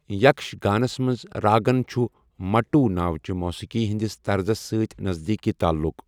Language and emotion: Kashmiri, neutral